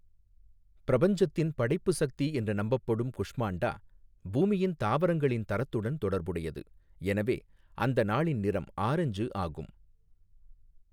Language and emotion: Tamil, neutral